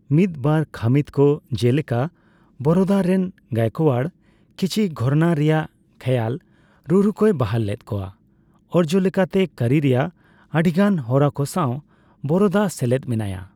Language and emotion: Santali, neutral